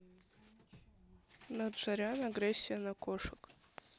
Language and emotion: Russian, neutral